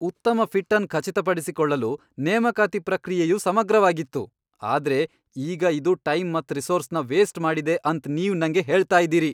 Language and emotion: Kannada, angry